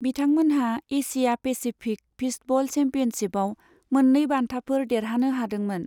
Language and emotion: Bodo, neutral